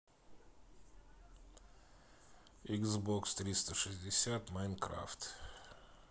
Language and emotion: Russian, neutral